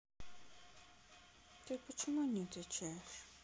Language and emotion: Russian, sad